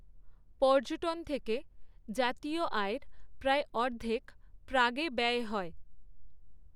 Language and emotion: Bengali, neutral